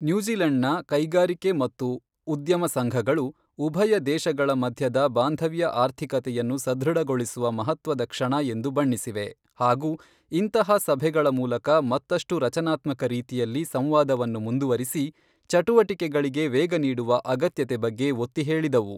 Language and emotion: Kannada, neutral